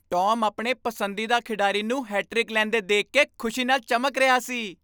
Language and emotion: Punjabi, happy